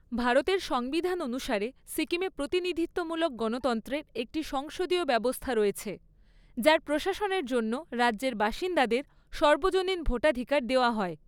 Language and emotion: Bengali, neutral